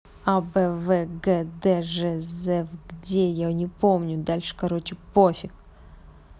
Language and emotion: Russian, angry